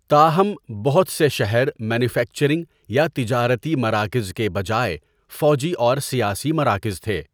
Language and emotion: Urdu, neutral